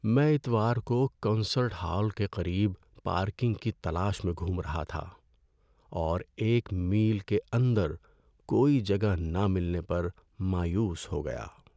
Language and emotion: Urdu, sad